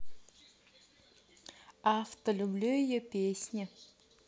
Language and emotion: Russian, neutral